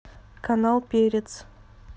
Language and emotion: Russian, neutral